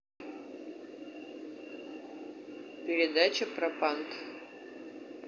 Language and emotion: Russian, neutral